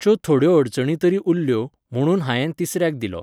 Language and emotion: Goan Konkani, neutral